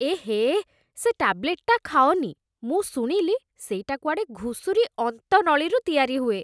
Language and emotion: Odia, disgusted